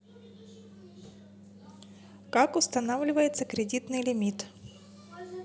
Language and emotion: Russian, neutral